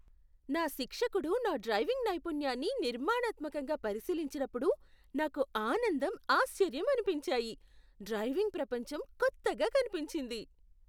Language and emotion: Telugu, surprised